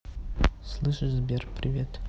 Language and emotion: Russian, neutral